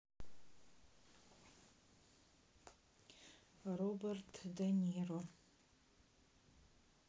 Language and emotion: Russian, neutral